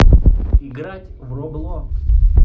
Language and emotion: Russian, neutral